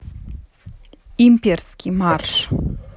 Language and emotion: Russian, neutral